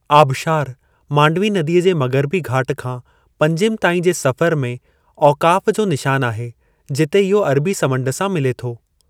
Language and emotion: Sindhi, neutral